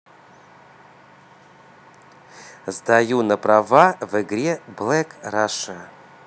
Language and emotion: Russian, positive